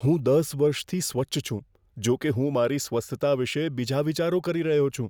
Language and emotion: Gujarati, fearful